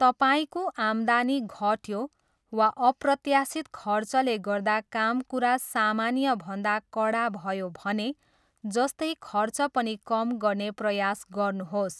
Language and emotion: Nepali, neutral